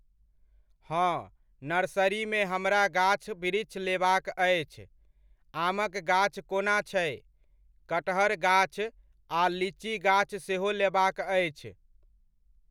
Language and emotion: Maithili, neutral